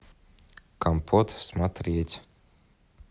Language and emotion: Russian, neutral